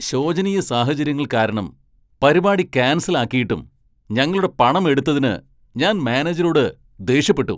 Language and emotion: Malayalam, angry